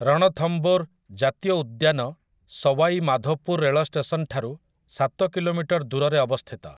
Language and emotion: Odia, neutral